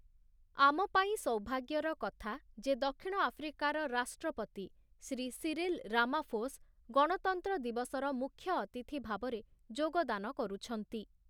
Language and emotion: Odia, neutral